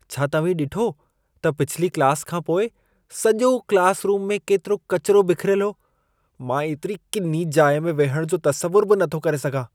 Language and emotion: Sindhi, disgusted